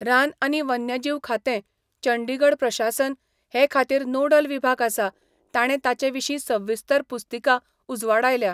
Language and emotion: Goan Konkani, neutral